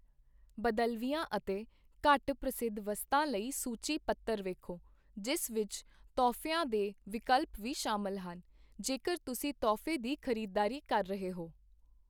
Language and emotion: Punjabi, neutral